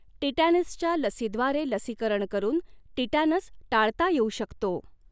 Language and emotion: Marathi, neutral